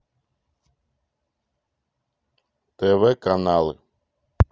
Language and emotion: Russian, neutral